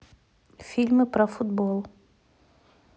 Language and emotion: Russian, neutral